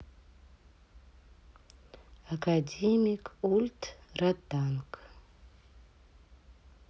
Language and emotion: Russian, neutral